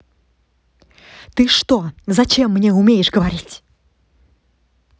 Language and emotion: Russian, angry